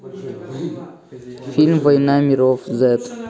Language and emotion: Russian, neutral